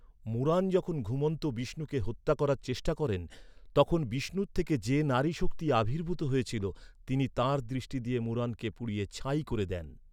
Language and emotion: Bengali, neutral